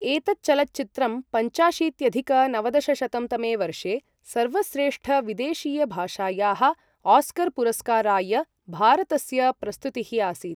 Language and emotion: Sanskrit, neutral